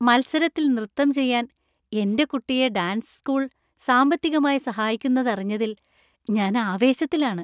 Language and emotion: Malayalam, happy